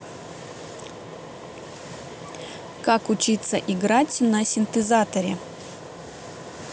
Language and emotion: Russian, neutral